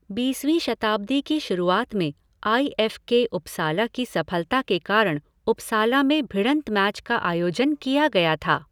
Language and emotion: Hindi, neutral